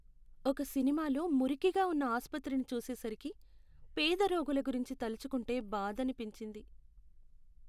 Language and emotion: Telugu, sad